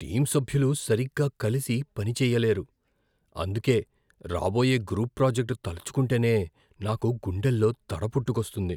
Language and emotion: Telugu, fearful